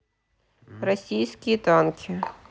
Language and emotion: Russian, neutral